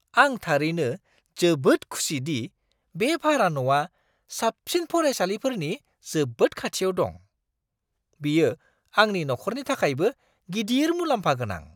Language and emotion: Bodo, surprised